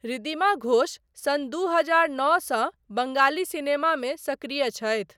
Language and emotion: Maithili, neutral